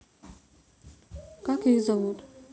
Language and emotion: Russian, neutral